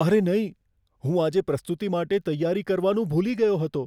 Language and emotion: Gujarati, fearful